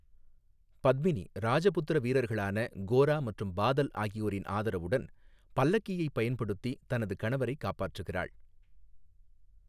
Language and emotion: Tamil, neutral